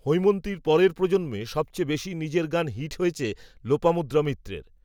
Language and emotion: Bengali, neutral